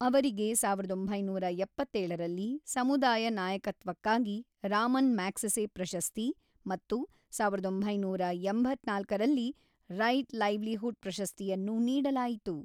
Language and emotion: Kannada, neutral